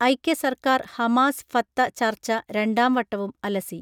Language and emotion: Malayalam, neutral